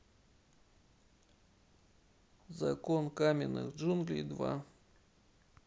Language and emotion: Russian, neutral